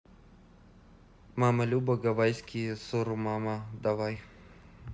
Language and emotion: Russian, neutral